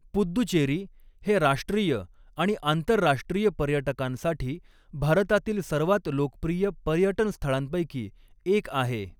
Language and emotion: Marathi, neutral